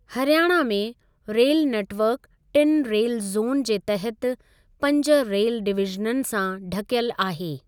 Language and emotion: Sindhi, neutral